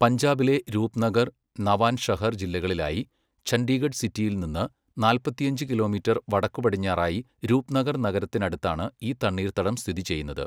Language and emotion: Malayalam, neutral